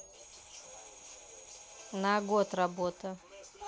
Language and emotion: Russian, neutral